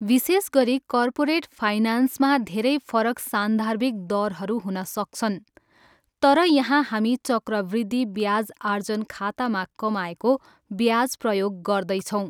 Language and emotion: Nepali, neutral